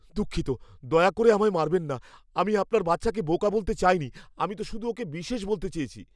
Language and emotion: Bengali, fearful